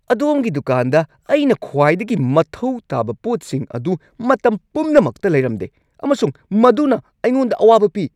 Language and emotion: Manipuri, angry